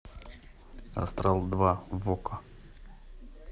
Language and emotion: Russian, neutral